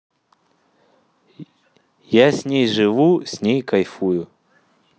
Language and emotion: Russian, positive